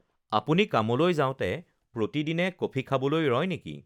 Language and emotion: Assamese, neutral